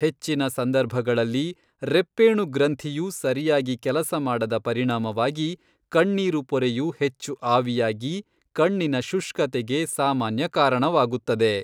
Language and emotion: Kannada, neutral